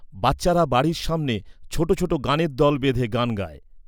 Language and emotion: Bengali, neutral